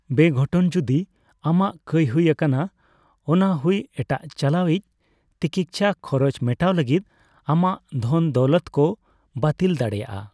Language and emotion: Santali, neutral